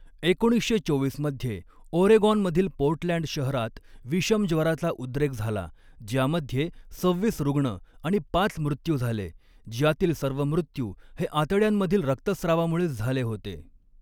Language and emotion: Marathi, neutral